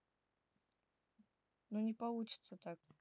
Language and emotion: Russian, neutral